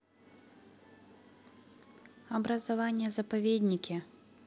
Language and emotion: Russian, neutral